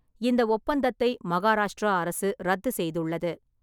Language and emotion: Tamil, neutral